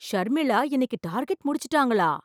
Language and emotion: Tamil, surprised